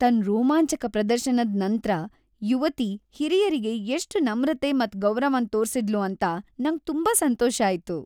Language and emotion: Kannada, happy